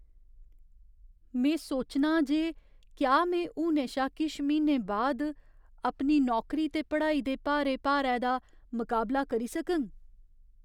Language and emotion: Dogri, fearful